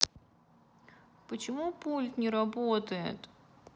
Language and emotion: Russian, sad